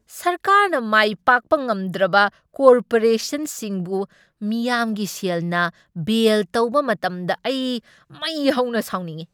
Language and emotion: Manipuri, angry